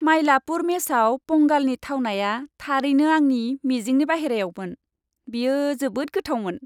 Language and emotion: Bodo, happy